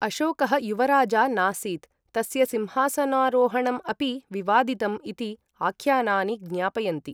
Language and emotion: Sanskrit, neutral